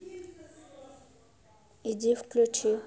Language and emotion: Russian, neutral